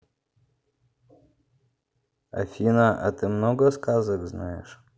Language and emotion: Russian, neutral